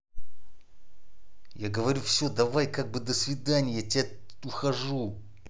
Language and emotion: Russian, angry